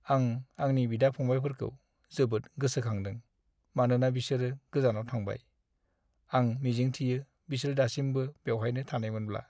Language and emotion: Bodo, sad